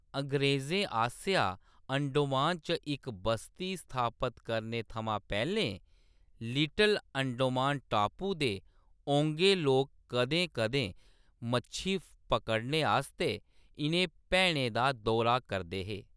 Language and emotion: Dogri, neutral